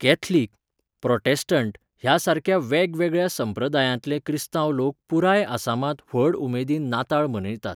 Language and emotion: Goan Konkani, neutral